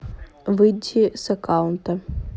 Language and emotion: Russian, neutral